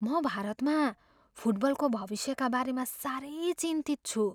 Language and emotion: Nepali, fearful